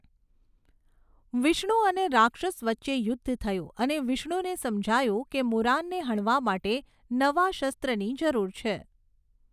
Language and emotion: Gujarati, neutral